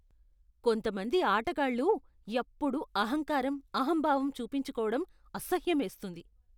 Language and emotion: Telugu, disgusted